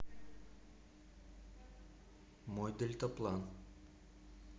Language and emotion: Russian, neutral